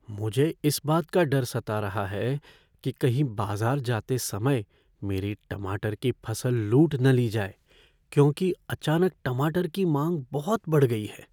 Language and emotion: Hindi, fearful